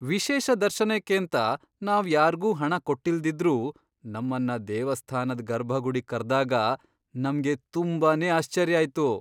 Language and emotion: Kannada, surprised